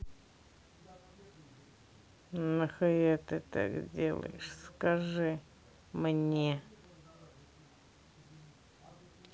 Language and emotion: Russian, neutral